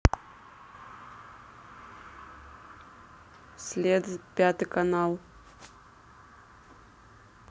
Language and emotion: Russian, neutral